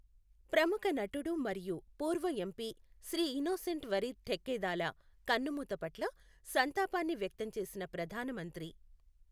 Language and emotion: Telugu, neutral